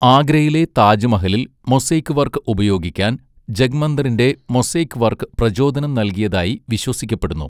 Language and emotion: Malayalam, neutral